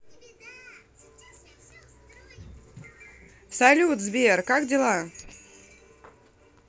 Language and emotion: Russian, positive